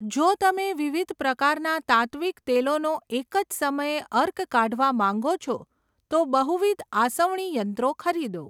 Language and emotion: Gujarati, neutral